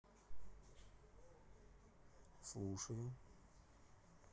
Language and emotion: Russian, neutral